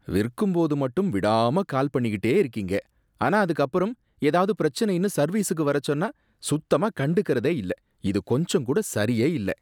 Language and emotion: Tamil, disgusted